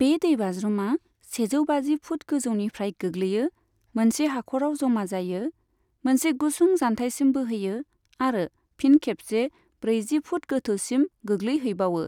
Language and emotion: Bodo, neutral